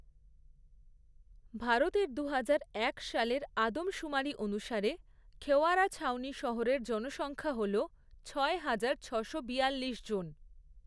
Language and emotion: Bengali, neutral